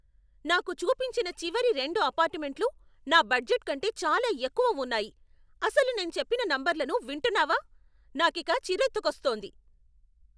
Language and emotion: Telugu, angry